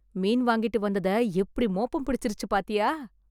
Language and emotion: Tamil, surprised